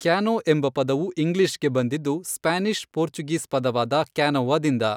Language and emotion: Kannada, neutral